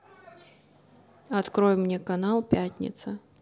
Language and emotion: Russian, neutral